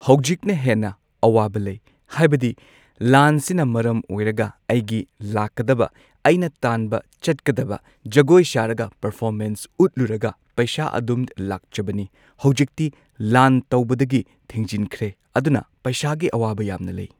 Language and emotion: Manipuri, neutral